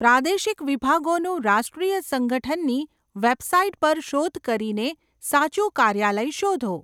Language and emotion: Gujarati, neutral